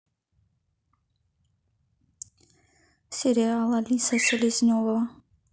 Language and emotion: Russian, neutral